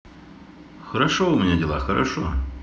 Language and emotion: Russian, positive